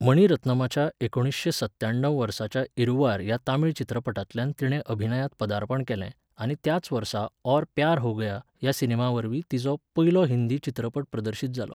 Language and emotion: Goan Konkani, neutral